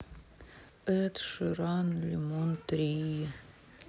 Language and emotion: Russian, sad